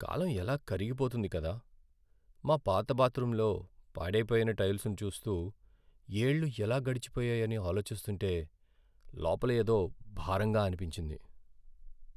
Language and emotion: Telugu, sad